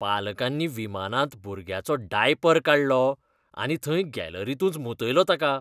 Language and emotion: Goan Konkani, disgusted